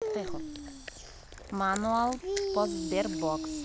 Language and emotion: Russian, neutral